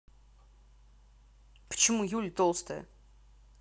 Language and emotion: Russian, angry